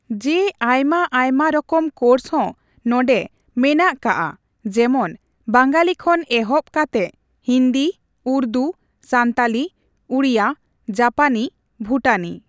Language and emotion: Santali, neutral